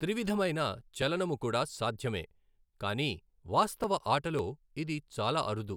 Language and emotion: Telugu, neutral